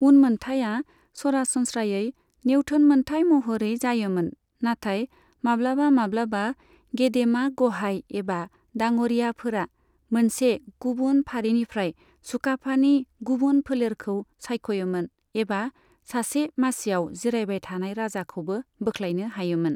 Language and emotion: Bodo, neutral